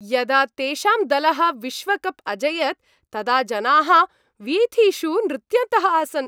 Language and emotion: Sanskrit, happy